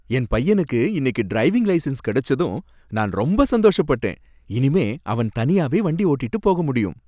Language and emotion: Tamil, happy